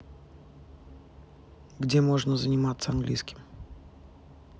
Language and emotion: Russian, neutral